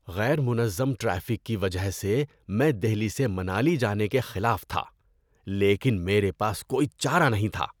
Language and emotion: Urdu, disgusted